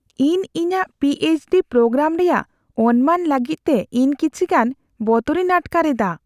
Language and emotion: Santali, fearful